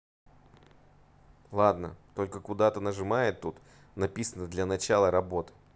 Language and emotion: Russian, neutral